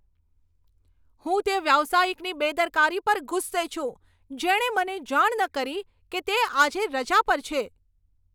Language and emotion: Gujarati, angry